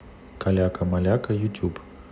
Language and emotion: Russian, neutral